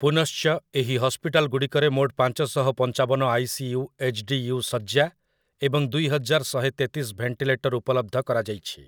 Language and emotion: Odia, neutral